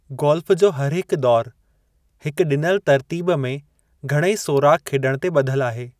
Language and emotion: Sindhi, neutral